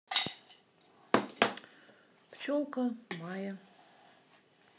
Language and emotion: Russian, neutral